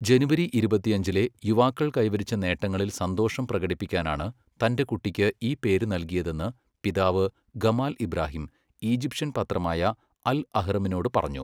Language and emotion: Malayalam, neutral